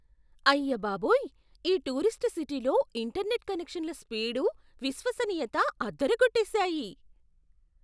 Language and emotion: Telugu, surprised